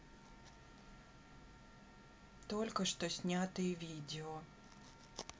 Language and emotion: Russian, neutral